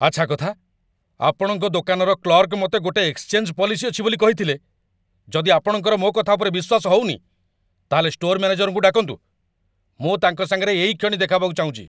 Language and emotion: Odia, angry